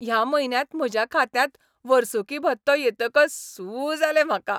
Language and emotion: Goan Konkani, happy